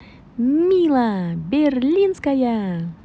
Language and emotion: Russian, positive